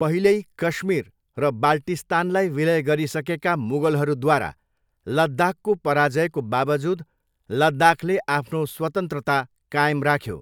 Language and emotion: Nepali, neutral